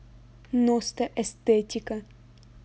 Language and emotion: Russian, angry